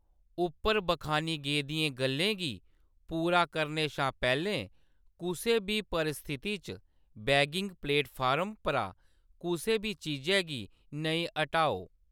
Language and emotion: Dogri, neutral